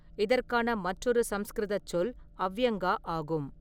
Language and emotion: Tamil, neutral